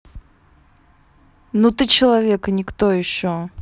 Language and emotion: Russian, angry